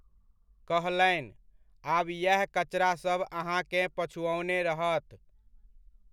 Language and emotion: Maithili, neutral